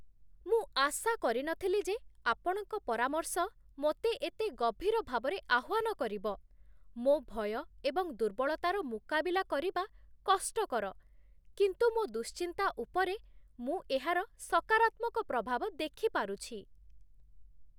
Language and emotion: Odia, surprised